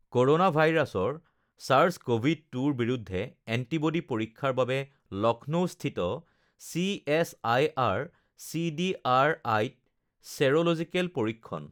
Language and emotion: Assamese, neutral